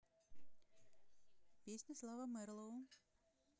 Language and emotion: Russian, neutral